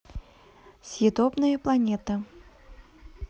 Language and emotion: Russian, neutral